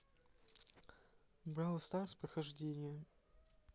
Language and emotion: Russian, neutral